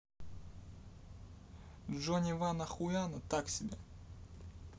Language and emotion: Russian, neutral